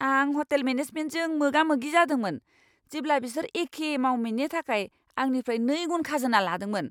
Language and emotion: Bodo, angry